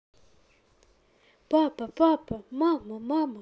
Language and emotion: Russian, neutral